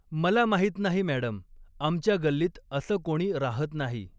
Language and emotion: Marathi, neutral